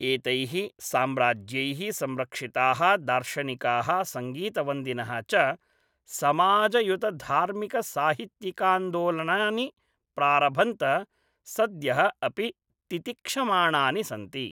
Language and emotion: Sanskrit, neutral